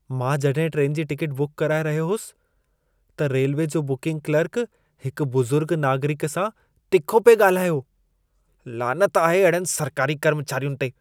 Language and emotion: Sindhi, disgusted